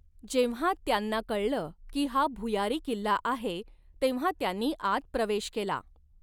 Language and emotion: Marathi, neutral